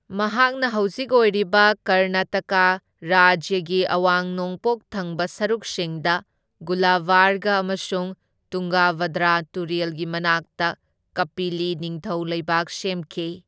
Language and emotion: Manipuri, neutral